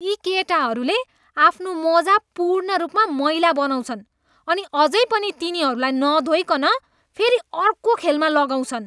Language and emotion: Nepali, disgusted